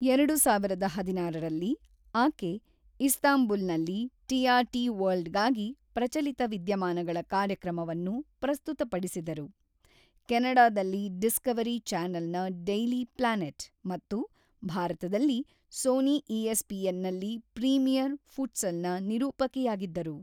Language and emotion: Kannada, neutral